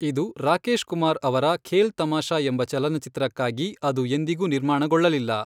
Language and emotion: Kannada, neutral